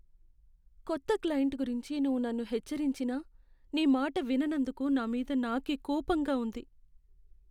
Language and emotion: Telugu, sad